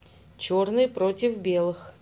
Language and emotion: Russian, neutral